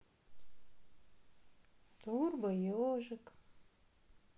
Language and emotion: Russian, sad